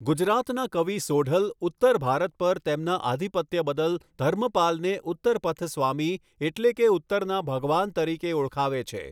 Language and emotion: Gujarati, neutral